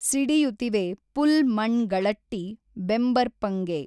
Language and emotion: Kannada, neutral